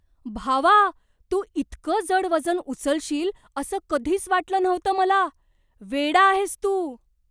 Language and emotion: Marathi, surprised